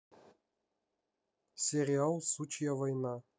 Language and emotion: Russian, neutral